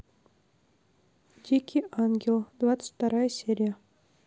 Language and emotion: Russian, neutral